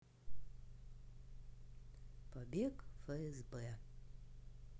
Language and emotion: Russian, neutral